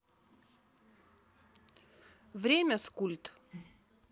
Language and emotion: Russian, neutral